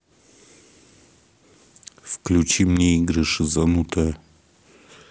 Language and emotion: Russian, angry